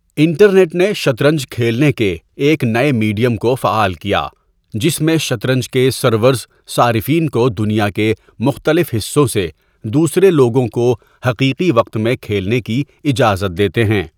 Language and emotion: Urdu, neutral